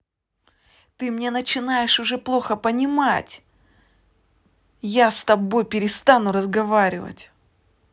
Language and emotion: Russian, angry